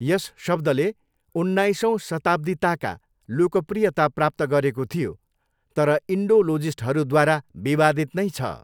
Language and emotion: Nepali, neutral